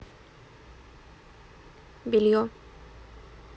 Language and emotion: Russian, neutral